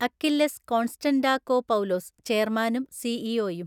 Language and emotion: Malayalam, neutral